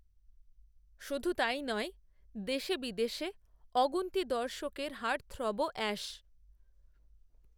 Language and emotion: Bengali, neutral